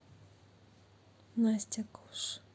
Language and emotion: Russian, neutral